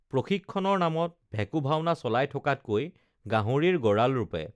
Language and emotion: Assamese, neutral